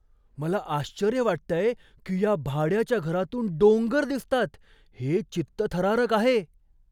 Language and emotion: Marathi, surprised